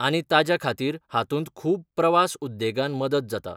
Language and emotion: Goan Konkani, neutral